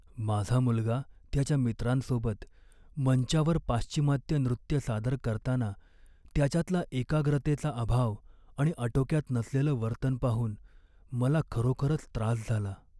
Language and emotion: Marathi, sad